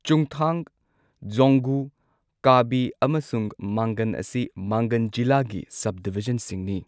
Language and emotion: Manipuri, neutral